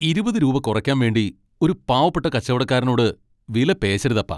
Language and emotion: Malayalam, angry